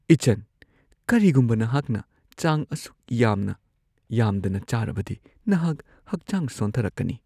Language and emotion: Manipuri, fearful